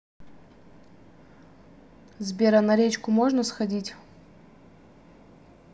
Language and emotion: Russian, neutral